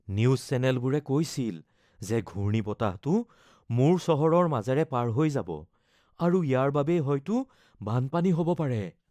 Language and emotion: Assamese, fearful